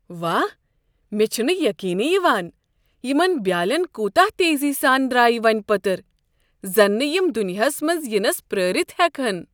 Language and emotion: Kashmiri, surprised